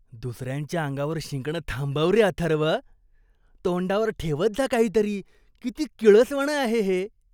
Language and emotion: Marathi, disgusted